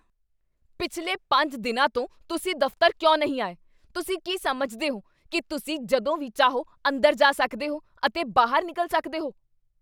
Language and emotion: Punjabi, angry